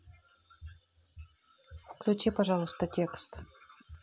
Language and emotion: Russian, neutral